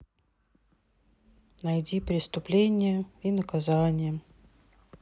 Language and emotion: Russian, sad